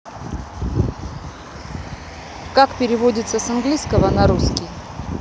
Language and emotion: Russian, neutral